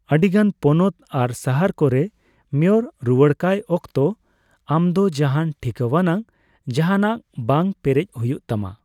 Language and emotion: Santali, neutral